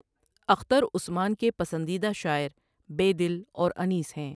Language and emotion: Urdu, neutral